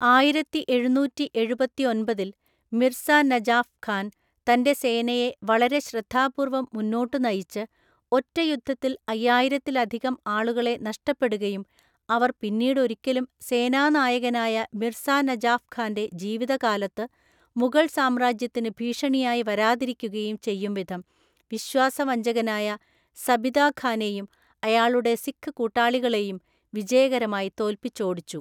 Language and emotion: Malayalam, neutral